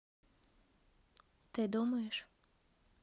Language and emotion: Russian, neutral